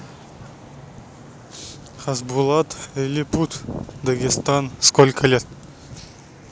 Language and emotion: Russian, neutral